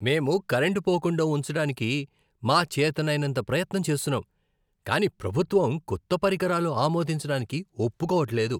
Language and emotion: Telugu, disgusted